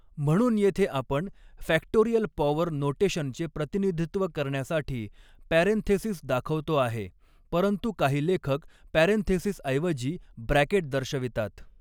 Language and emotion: Marathi, neutral